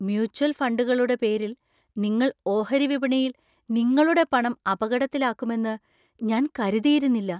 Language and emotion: Malayalam, surprised